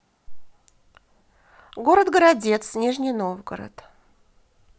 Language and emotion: Russian, positive